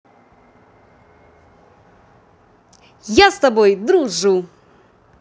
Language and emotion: Russian, positive